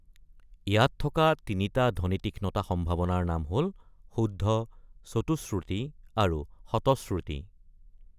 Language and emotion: Assamese, neutral